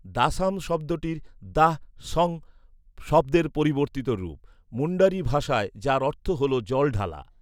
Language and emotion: Bengali, neutral